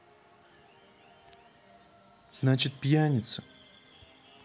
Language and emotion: Russian, sad